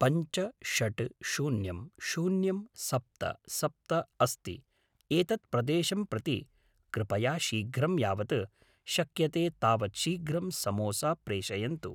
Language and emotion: Sanskrit, neutral